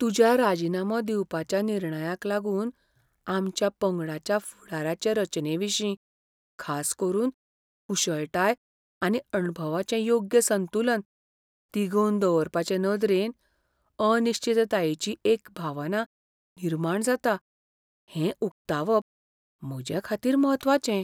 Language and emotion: Goan Konkani, fearful